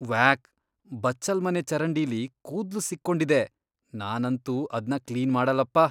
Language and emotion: Kannada, disgusted